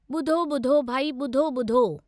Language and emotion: Sindhi, neutral